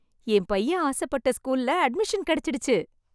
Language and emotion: Tamil, happy